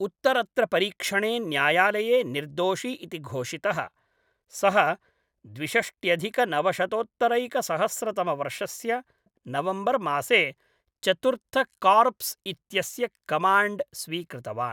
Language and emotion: Sanskrit, neutral